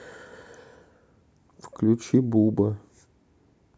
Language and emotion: Russian, neutral